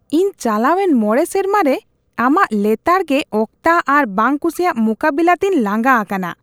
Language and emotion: Santali, disgusted